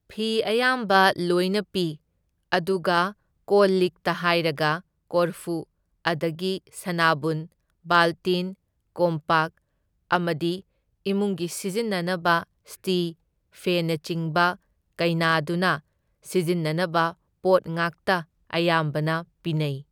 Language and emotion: Manipuri, neutral